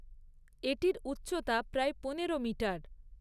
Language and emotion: Bengali, neutral